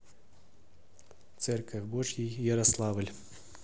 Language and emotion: Russian, neutral